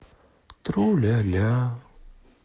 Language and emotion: Russian, sad